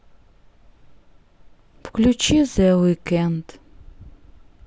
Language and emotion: Russian, sad